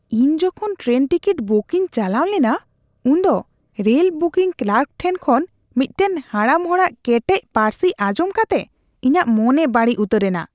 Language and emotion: Santali, disgusted